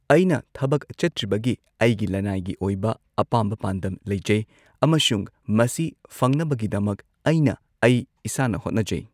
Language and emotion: Manipuri, neutral